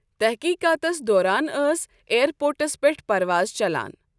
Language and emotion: Kashmiri, neutral